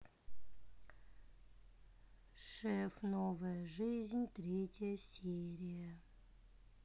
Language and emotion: Russian, sad